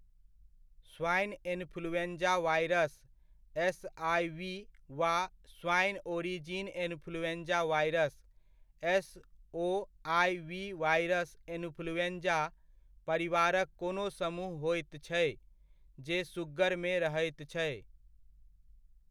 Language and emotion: Maithili, neutral